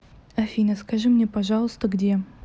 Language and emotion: Russian, neutral